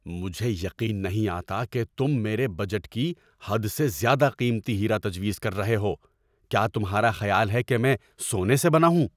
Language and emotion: Urdu, angry